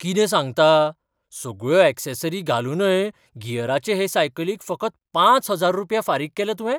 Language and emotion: Goan Konkani, surprised